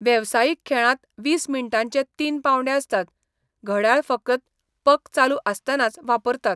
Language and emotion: Goan Konkani, neutral